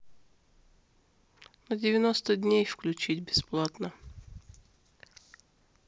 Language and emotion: Russian, neutral